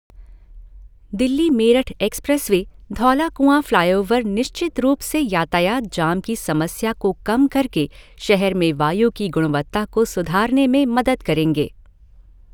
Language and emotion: Hindi, neutral